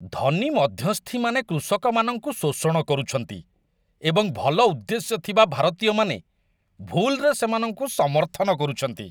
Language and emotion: Odia, disgusted